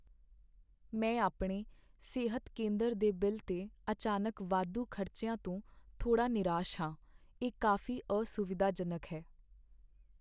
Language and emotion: Punjabi, sad